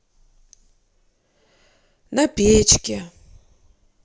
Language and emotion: Russian, sad